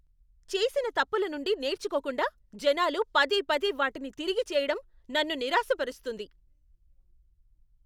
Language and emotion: Telugu, angry